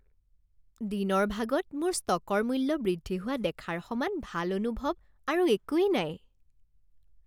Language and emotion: Assamese, happy